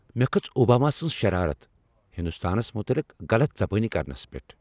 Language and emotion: Kashmiri, angry